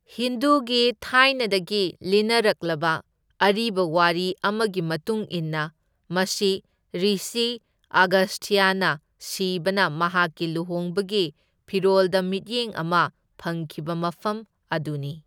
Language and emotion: Manipuri, neutral